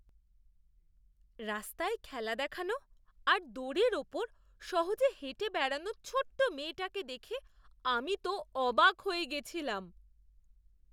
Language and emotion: Bengali, surprised